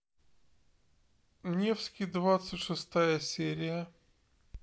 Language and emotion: Russian, neutral